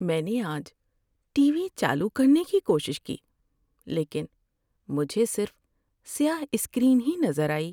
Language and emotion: Urdu, sad